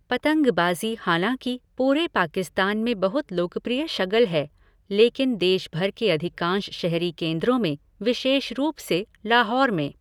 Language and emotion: Hindi, neutral